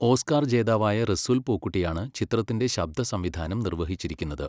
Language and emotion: Malayalam, neutral